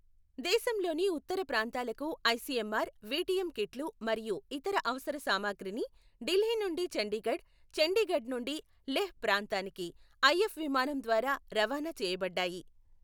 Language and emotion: Telugu, neutral